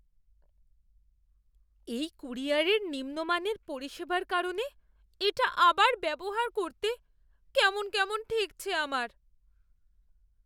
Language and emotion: Bengali, fearful